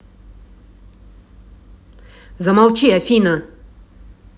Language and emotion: Russian, angry